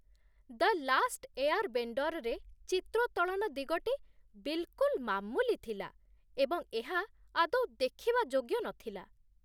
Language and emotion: Odia, disgusted